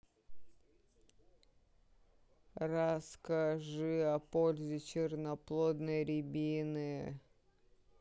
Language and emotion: Russian, neutral